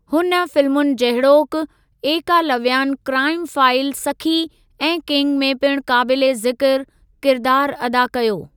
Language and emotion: Sindhi, neutral